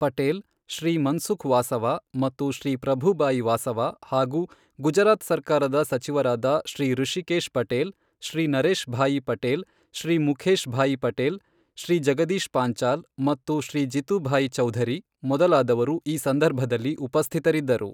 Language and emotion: Kannada, neutral